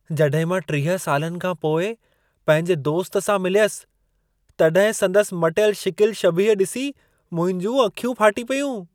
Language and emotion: Sindhi, surprised